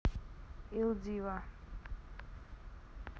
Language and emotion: Russian, neutral